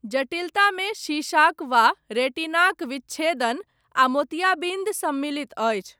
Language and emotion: Maithili, neutral